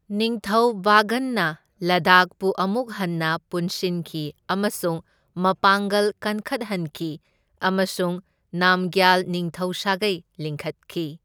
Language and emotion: Manipuri, neutral